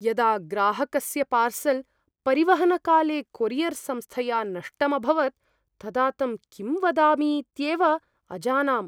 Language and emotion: Sanskrit, fearful